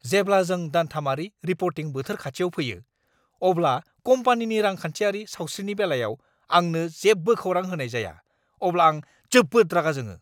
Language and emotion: Bodo, angry